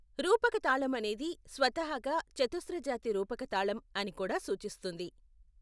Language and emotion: Telugu, neutral